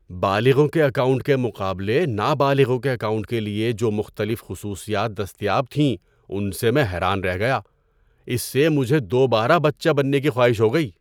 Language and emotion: Urdu, surprised